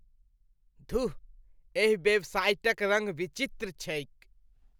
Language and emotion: Maithili, disgusted